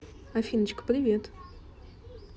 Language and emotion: Russian, positive